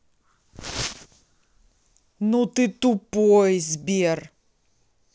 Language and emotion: Russian, angry